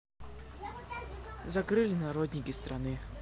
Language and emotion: Russian, neutral